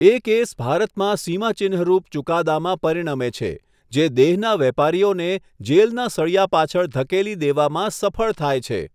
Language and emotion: Gujarati, neutral